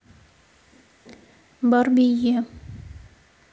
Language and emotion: Russian, neutral